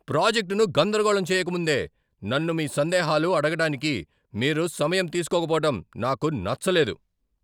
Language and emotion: Telugu, angry